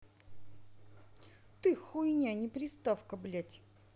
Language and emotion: Russian, angry